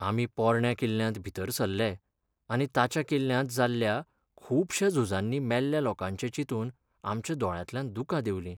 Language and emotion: Goan Konkani, sad